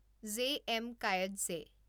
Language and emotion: Assamese, neutral